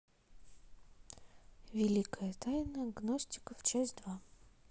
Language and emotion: Russian, neutral